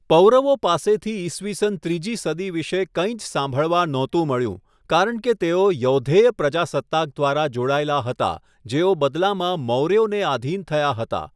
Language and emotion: Gujarati, neutral